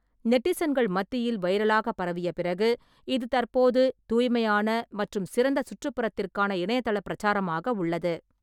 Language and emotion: Tamil, neutral